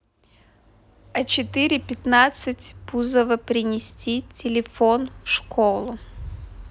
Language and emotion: Russian, neutral